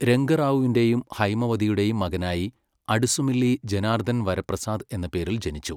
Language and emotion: Malayalam, neutral